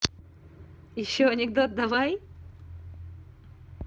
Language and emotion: Russian, positive